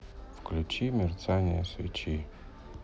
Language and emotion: Russian, sad